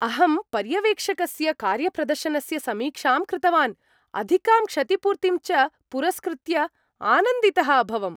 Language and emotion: Sanskrit, happy